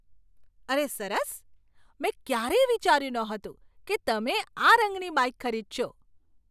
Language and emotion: Gujarati, surprised